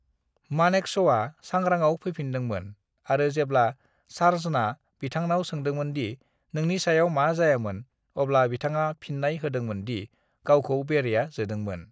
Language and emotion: Bodo, neutral